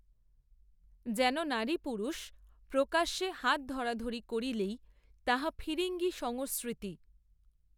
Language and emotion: Bengali, neutral